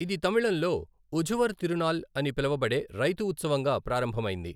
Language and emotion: Telugu, neutral